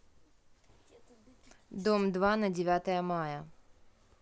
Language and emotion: Russian, neutral